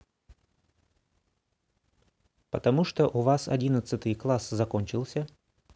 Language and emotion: Russian, neutral